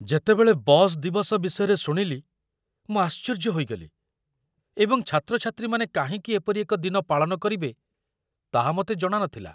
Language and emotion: Odia, surprised